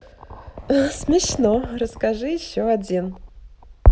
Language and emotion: Russian, positive